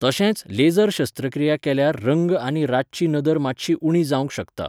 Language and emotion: Goan Konkani, neutral